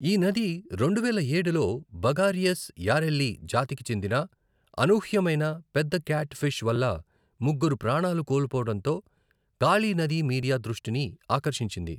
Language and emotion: Telugu, neutral